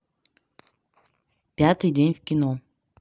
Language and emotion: Russian, neutral